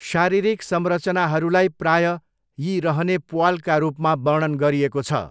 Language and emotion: Nepali, neutral